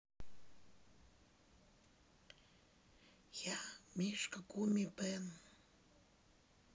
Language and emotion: Russian, sad